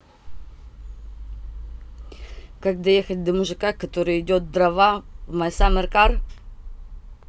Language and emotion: Russian, neutral